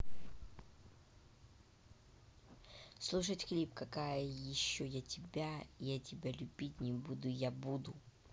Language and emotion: Russian, neutral